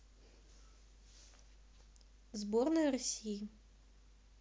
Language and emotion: Russian, neutral